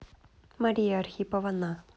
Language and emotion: Russian, neutral